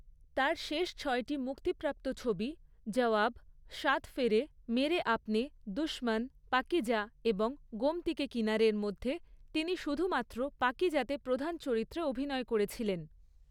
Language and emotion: Bengali, neutral